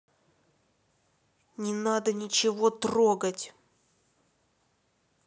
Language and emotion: Russian, angry